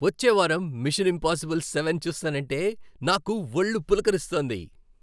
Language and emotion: Telugu, happy